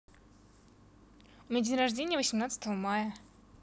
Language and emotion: Russian, positive